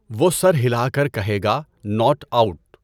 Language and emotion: Urdu, neutral